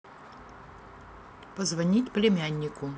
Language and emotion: Russian, neutral